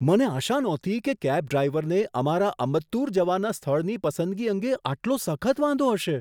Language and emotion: Gujarati, surprised